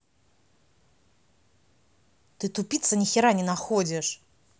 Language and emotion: Russian, angry